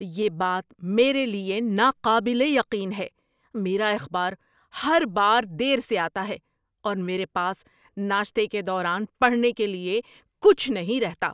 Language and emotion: Urdu, angry